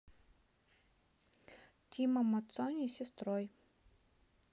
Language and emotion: Russian, neutral